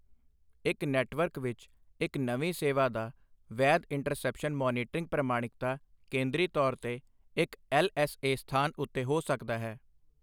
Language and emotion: Punjabi, neutral